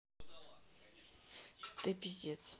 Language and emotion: Russian, sad